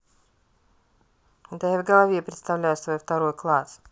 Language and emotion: Russian, neutral